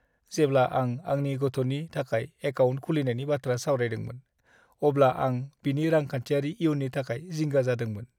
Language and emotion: Bodo, sad